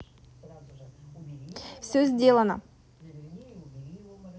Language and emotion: Russian, positive